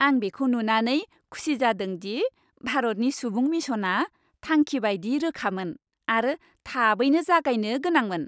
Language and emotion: Bodo, happy